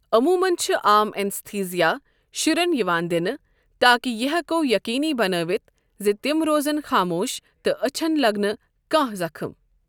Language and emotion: Kashmiri, neutral